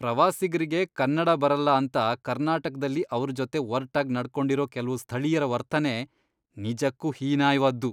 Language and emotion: Kannada, disgusted